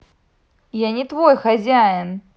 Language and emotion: Russian, angry